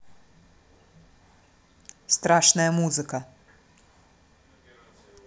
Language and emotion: Russian, neutral